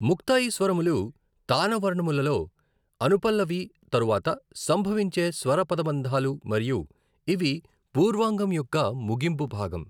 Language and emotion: Telugu, neutral